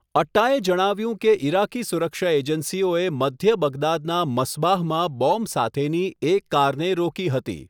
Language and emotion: Gujarati, neutral